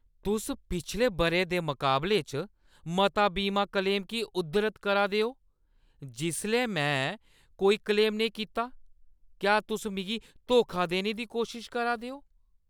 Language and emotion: Dogri, angry